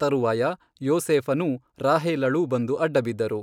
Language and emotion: Kannada, neutral